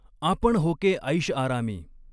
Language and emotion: Marathi, neutral